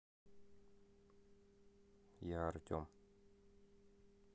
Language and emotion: Russian, neutral